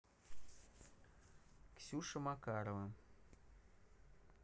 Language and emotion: Russian, neutral